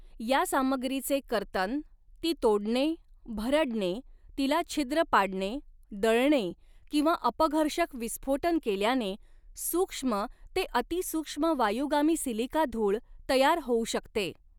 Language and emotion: Marathi, neutral